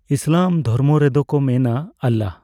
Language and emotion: Santali, neutral